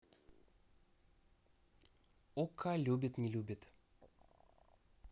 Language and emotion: Russian, neutral